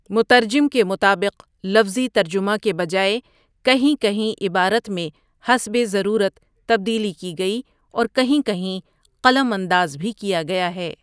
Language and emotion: Urdu, neutral